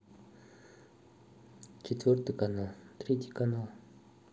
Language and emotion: Russian, neutral